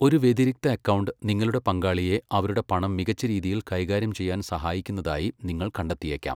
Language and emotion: Malayalam, neutral